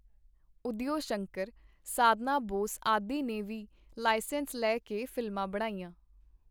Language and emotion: Punjabi, neutral